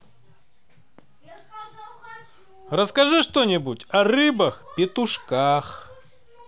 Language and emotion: Russian, positive